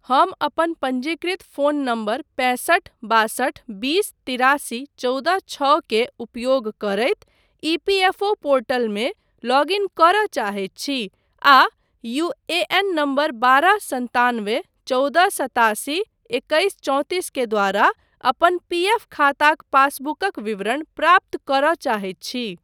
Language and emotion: Maithili, neutral